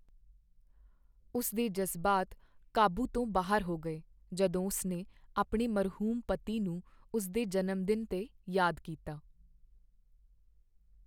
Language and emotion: Punjabi, sad